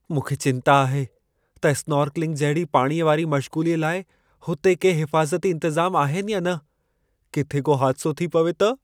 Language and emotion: Sindhi, fearful